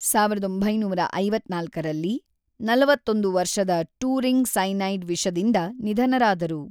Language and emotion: Kannada, neutral